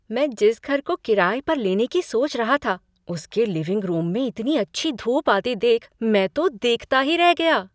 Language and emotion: Hindi, surprised